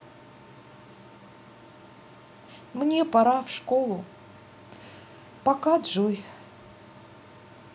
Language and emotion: Russian, sad